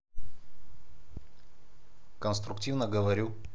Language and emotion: Russian, neutral